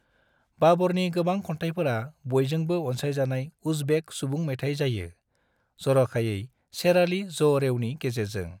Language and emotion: Bodo, neutral